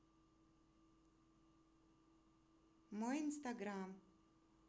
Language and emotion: Russian, neutral